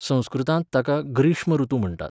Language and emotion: Goan Konkani, neutral